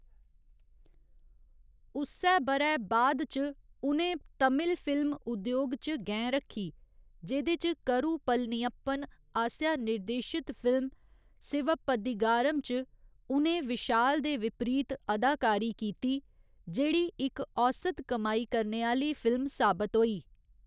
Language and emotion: Dogri, neutral